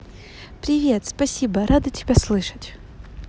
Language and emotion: Russian, positive